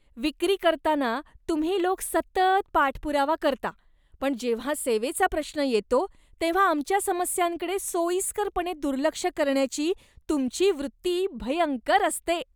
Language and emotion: Marathi, disgusted